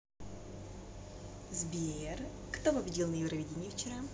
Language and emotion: Russian, positive